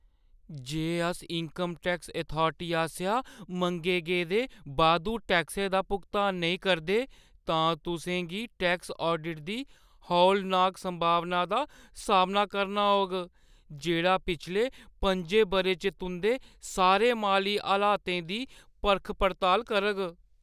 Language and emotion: Dogri, fearful